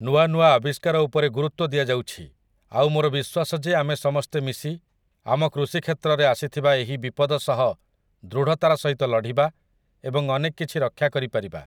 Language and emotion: Odia, neutral